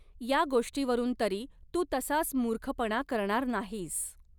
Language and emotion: Marathi, neutral